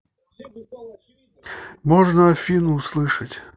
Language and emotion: Russian, neutral